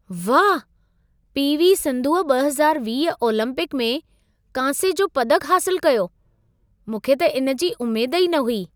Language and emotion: Sindhi, surprised